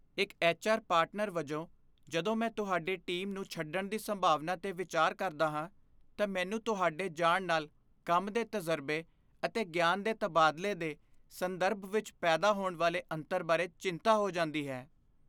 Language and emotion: Punjabi, fearful